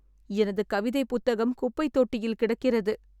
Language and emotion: Tamil, sad